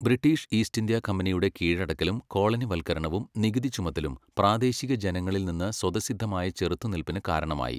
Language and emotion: Malayalam, neutral